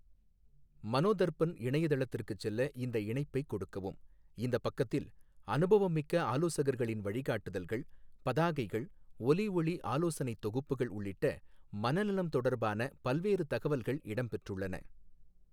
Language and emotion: Tamil, neutral